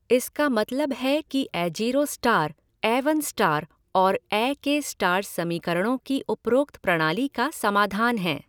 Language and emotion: Hindi, neutral